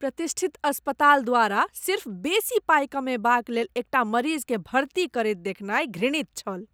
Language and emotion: Maithili, disgusted